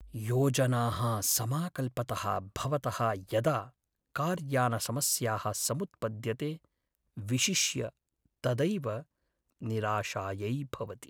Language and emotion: Sanskrit, sad